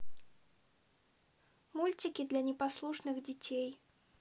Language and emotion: Russian, neutral